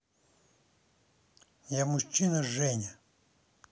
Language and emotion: Russian, neutral